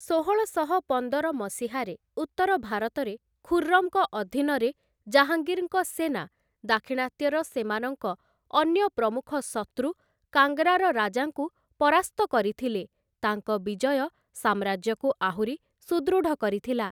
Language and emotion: Odia, neutral